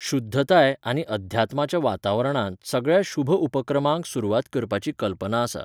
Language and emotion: Goan Konkani, neutral